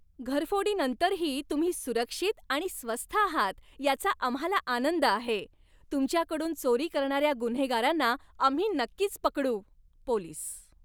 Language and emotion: Marathi, happy